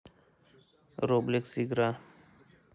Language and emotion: Russian, neutral